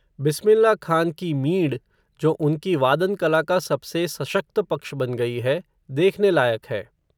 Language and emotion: Hindi, neutral